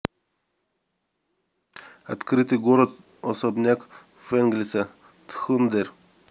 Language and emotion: Russian, neutral